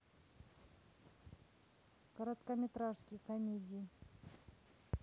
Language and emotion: Russian, neutral